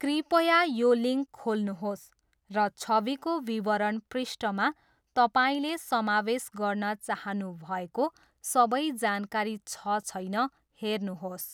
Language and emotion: Nepali, neutral